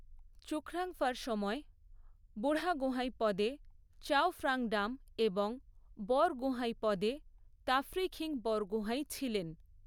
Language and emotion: Bengali, neutral